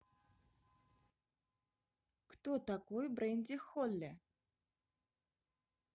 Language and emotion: Russian, neutral